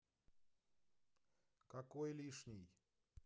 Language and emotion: Russian, neutral